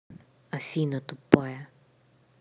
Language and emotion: Russian, angry